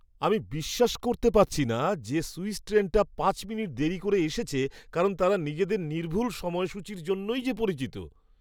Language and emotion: Bengali, surprised